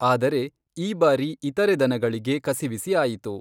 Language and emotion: Kannada, neutral